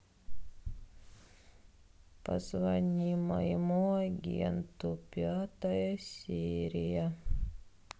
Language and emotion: Russian, sad